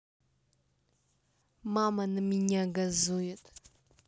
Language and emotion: Russian, neutral